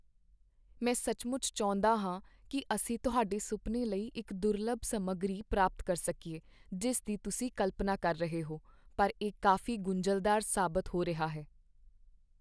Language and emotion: Punjabi, sad